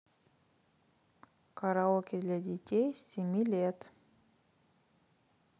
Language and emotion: Russian, neutral